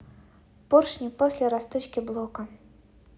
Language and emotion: Russian, neutral